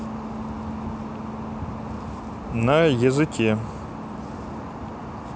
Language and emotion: Russian, neutral